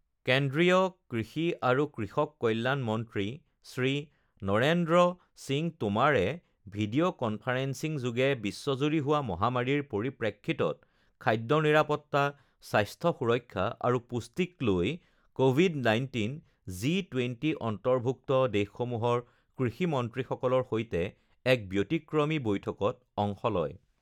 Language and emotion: Assamese, neutral